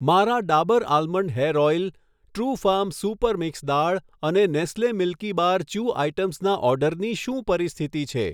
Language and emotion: Gujarati, neutral